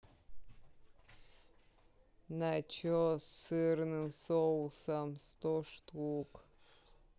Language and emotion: Russian, sad